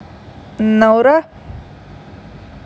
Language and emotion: Russian, neutral